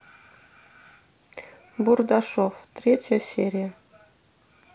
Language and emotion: Russian, neutral